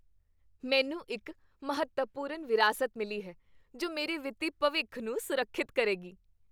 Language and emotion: Punjabi, happy